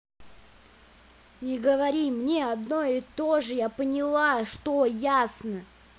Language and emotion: Russian, angry